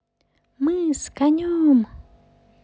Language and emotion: Russian, positive